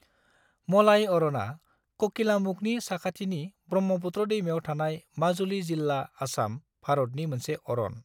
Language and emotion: Bodo, neutral